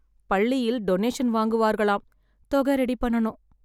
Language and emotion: Tamil, sad